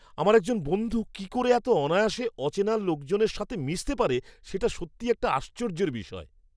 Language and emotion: Bengali, surprised